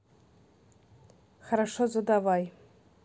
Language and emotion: Russian, neutral